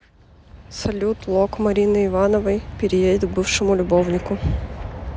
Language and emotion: Russian, neutral